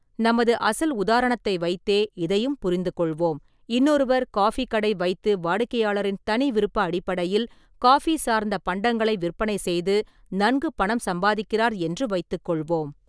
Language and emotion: Tamil, neutral